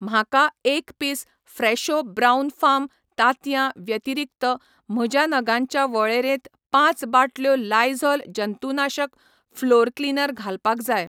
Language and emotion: Goan Konkani, neutral